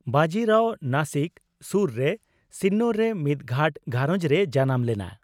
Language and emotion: Santali, neutral